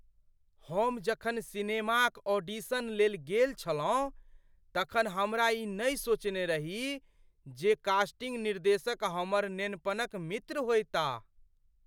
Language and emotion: Maithili, surprised